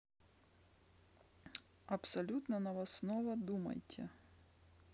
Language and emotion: Russian, neutral